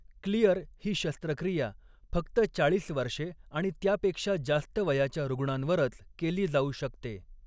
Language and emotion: Marathi, neutral